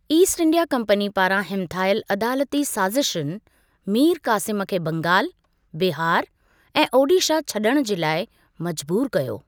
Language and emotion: Sindhi, neutral